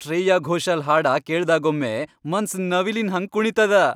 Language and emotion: Kannada, happy